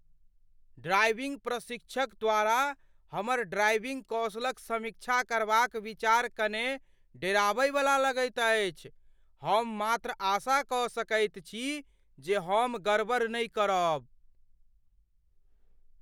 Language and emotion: Maithili, fearful